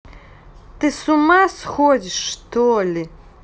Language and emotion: Russian, angry